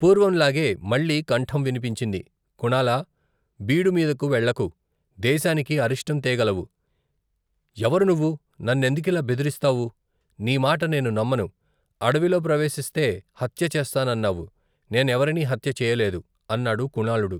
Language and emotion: Telugu, neutral